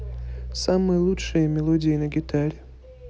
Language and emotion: Russian, neutral